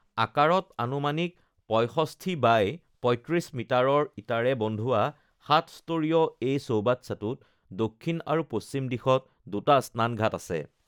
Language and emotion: Assamese, neutral